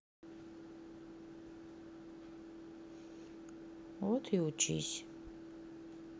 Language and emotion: Russian, sad